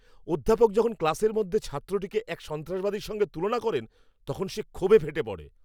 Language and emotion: Bengali, angry